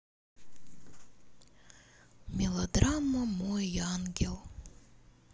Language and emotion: Russian, sad